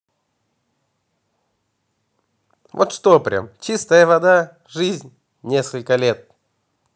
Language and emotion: Russian, positive